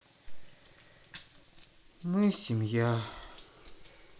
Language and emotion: Russian, sad